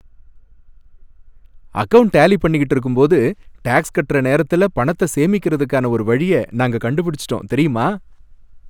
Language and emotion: Tamil, happy